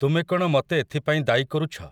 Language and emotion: Odia, neutral